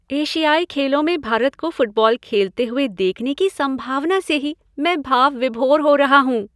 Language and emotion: Hindi, happy